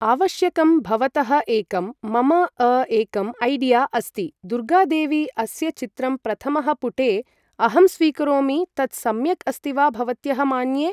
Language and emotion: Sanskrit, neutral